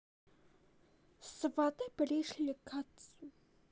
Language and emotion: Russian, neutral